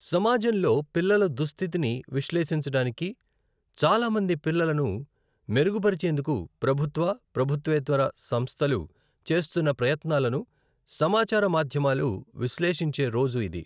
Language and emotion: Telugu, neutral